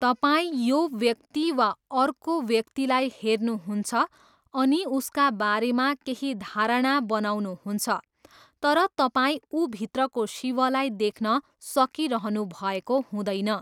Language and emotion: Nepali, neutral